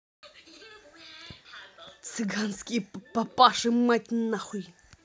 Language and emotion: Russian, angry